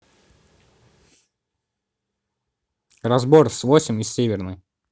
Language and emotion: Russian, neutral